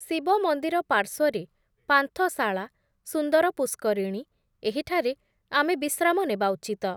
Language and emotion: Odia, neutral